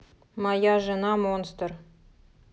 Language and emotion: Russian, neutral